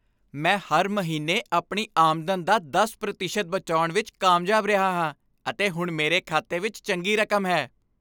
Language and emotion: Punjabi, happy